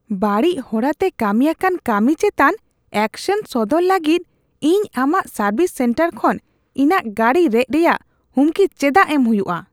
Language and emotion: Santali, disgusted